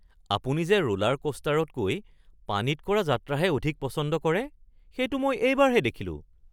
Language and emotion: Assamese, surprised